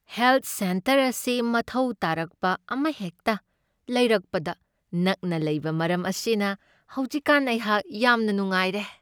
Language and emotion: Manipuri, happy